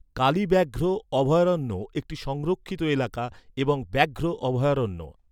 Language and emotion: Bengali, neutral